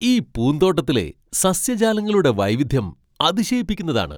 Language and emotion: Malayalam, surprised